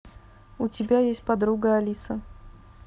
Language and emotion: Russian, neutral